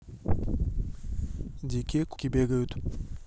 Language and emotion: Russian, neutral